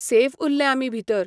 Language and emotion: Goan Konkani, neutral